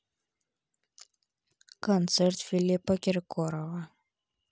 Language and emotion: Russian, neutral